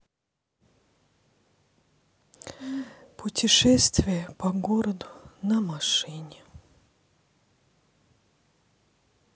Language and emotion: Russian, sad